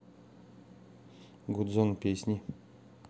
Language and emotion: Russian, neutral